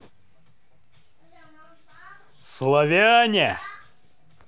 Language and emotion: Russian, positive